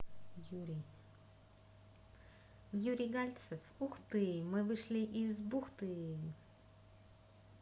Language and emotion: Russian, positive